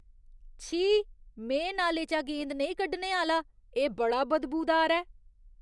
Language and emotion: Dogri, disgusted